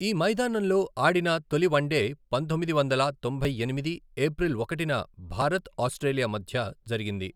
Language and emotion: Telugu, neutral